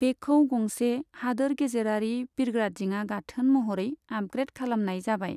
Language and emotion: Bodo, neutral